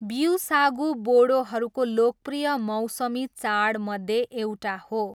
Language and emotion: Nepali, neutral